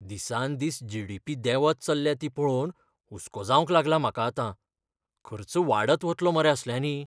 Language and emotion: Goan Konkani, fearful